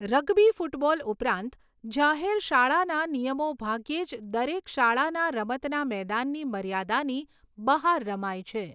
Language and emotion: Gujarati, neutral